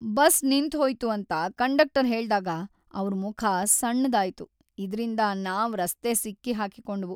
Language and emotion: Kannada, sad